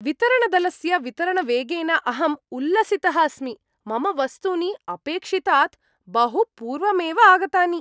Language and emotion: Sanskrit, happy